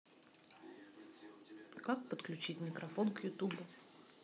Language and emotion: Russian, neutral